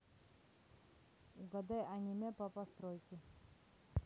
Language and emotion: Russian, neutral